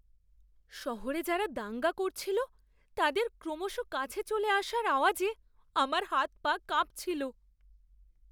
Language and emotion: Bengali, fearful